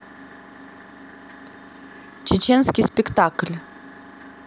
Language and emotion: Russian, neutral